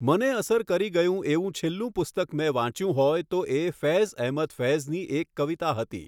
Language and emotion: Gujarati, neutral